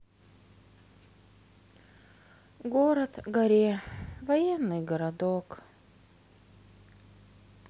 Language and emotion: Russian, sad